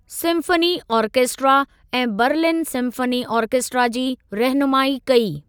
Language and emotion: Sindhi, neutral